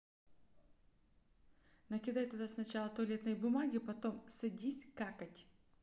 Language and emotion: Russian, neutral